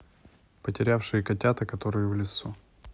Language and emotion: Russian, neutral